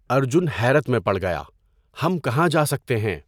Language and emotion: Urdu, neutral